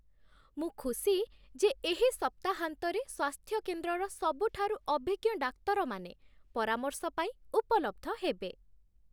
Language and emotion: Odia, happy